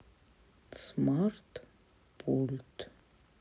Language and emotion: Russian, neutral